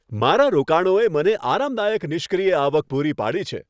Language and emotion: Gujarati, happy